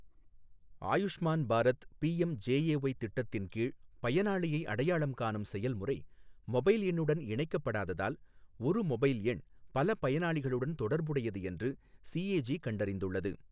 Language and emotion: Tamil, neutral